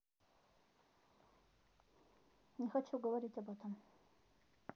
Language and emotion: Russian, neutral